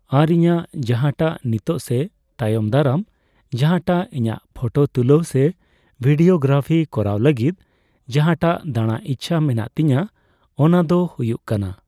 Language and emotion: Santali, neutral